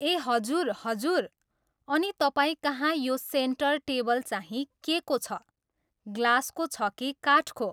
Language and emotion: Nepali, neutral